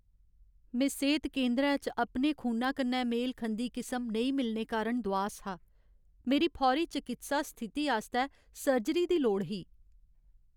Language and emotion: Dogri, sad